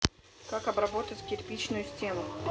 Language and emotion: Russian, neutral